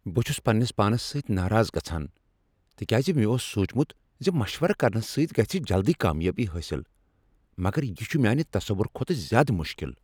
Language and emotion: Kashmiri, angry